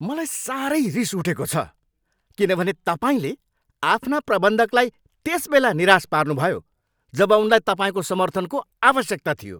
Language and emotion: Nepali, angry